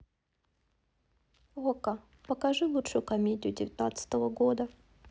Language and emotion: Russian, neutral